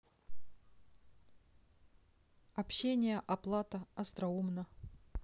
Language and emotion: Russian, neutral